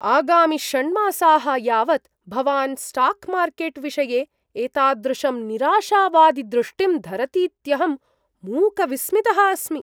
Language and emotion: Sanskrit, surprised